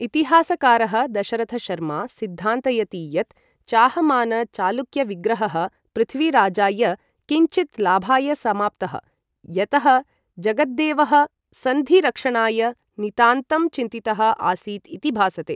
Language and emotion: Sanskrit, neutral